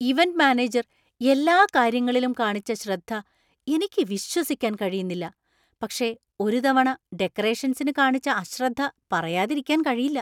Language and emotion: Malayalam, surprised